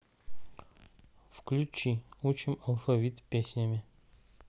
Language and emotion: Russian, neutral